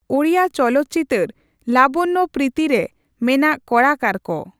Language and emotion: Santali, neutral